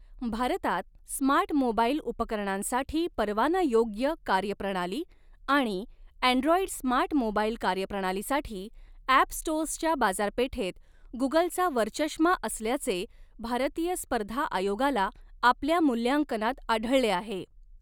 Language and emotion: Marathi, neutral